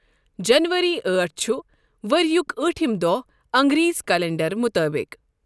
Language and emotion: Kashmiri, neutral